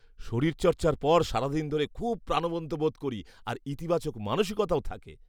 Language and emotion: Bengali, happy